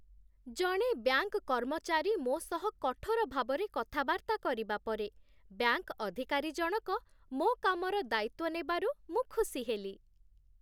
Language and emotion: Odia, happy